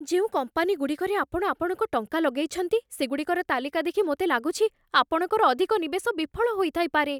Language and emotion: Odia, fearful